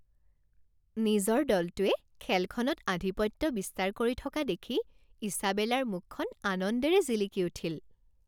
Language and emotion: Assamese, happy